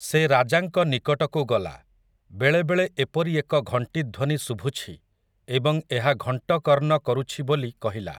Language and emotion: Odia, neutral